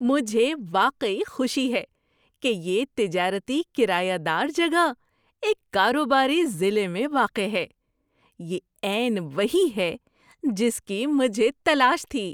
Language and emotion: Urdu, surprised